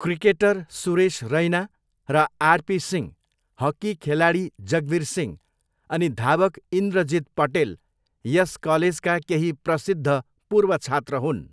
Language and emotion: Nepali, neutral